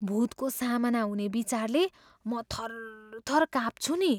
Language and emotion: Nepali, fearful